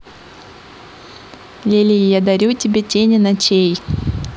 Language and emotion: Russian, neutral